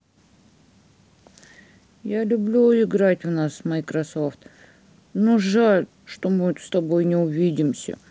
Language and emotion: Russian, sad